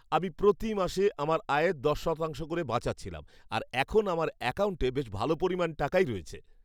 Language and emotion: Bengali, happy